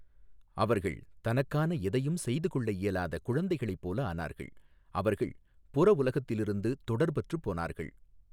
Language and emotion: Tamil, neutral